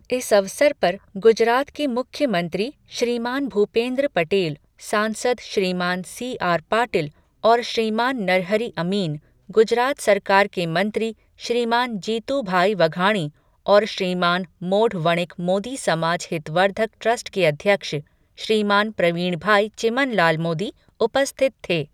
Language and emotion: Hindi, neutral